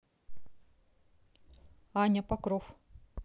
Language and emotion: Russian, neutral